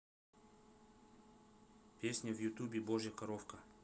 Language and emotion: Russian, neutral